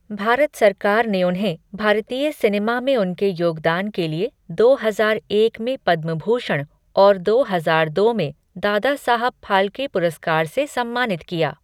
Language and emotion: Hindi, neutral